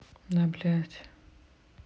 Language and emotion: Russian, angry